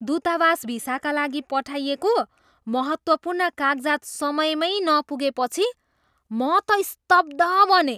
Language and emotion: Nepali, surprised